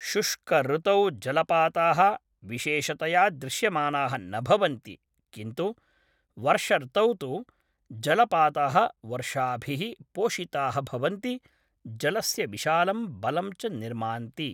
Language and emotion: Sanskrit, neutral